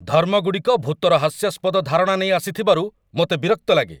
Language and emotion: Odia, angry